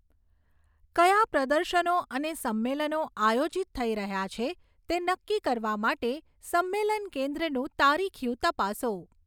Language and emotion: Gujarati, neutral